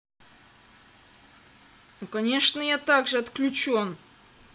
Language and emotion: Russian, angry